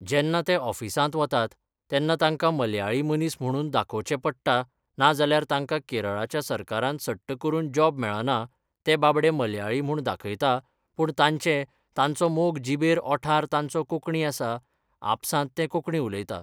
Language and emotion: Goan Konkani, neutral